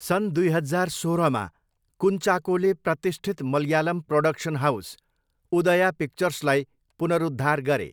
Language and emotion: Nepali, neutral